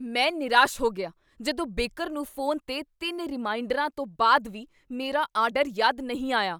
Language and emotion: Punjabi, angry